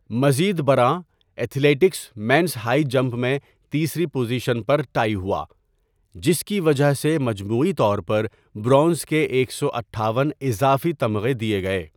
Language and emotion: Urdu, neutral